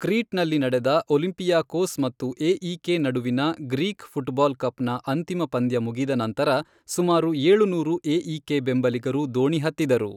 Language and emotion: Kannada, neutral